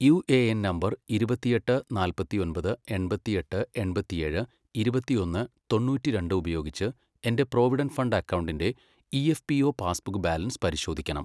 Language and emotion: Malayalam, neutral